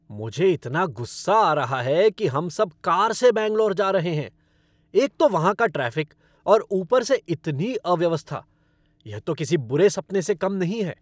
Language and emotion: Hindi, angry